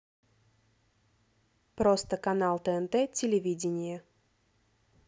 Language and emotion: Russian, neutral